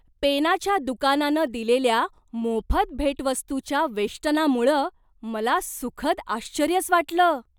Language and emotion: Marathi, surprised